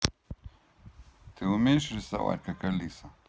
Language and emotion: Russian, neutral